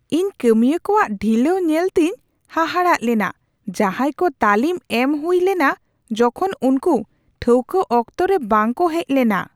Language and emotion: Santali, surprised